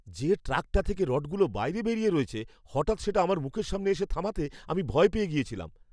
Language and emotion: Bengali, fearful